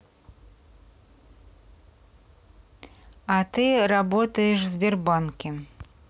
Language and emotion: Russian, neutral